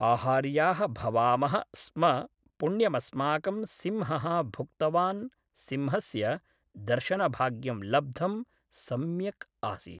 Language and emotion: Sanskrit, neutral